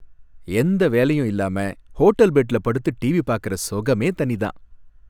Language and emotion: Tamil, happy